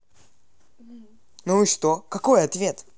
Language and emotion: Russian, angry